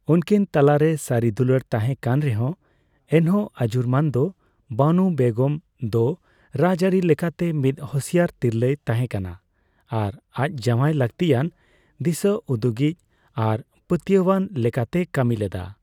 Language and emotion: Santali, neutral